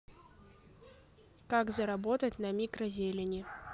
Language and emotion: Russian, neutral